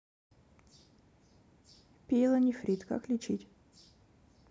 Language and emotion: Russian, neutral